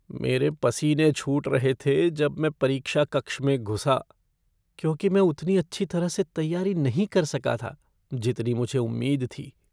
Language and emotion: Hindi, fearful